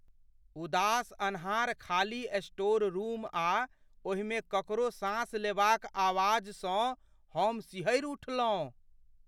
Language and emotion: Maithili, fearful